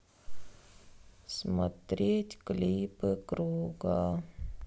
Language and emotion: Russian, sad